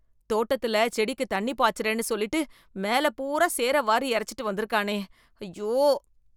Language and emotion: Tamil, disgusted